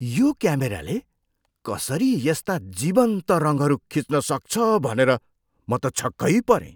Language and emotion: Nepali, surprised